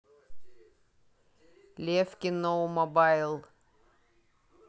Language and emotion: Russian, neutral